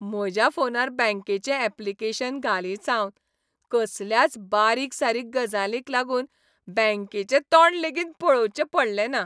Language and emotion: Goan Konkani, happy